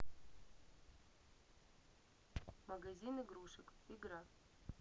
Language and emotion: Russian, neutral